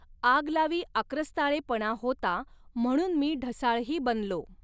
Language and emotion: Marathi, neutral